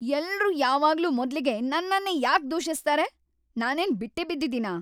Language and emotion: Kannada, angry